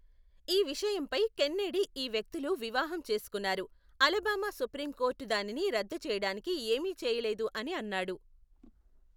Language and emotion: Telugu, neutral